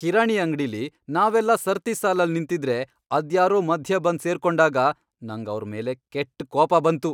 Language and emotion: Kannada, angry